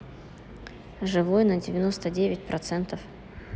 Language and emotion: Russian, neutral